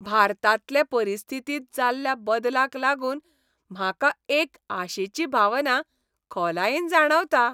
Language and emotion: Goan Konkani, happy